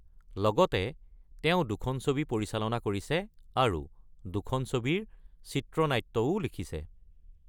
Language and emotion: Assamese, neutral